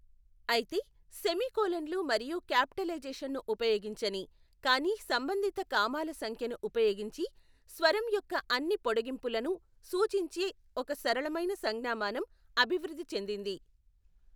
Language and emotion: Telugu, neutral